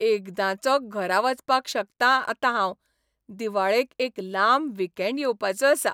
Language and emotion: Goan Konkani, happy